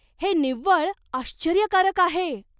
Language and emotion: Marathi, surprised